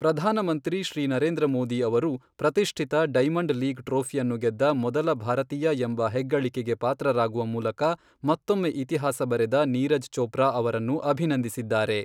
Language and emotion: Kannada, neutral